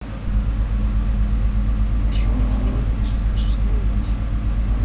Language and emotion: Russian, neutral